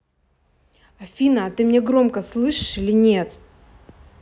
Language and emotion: Russian, angry